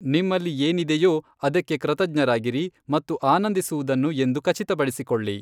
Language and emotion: Kannada, neutral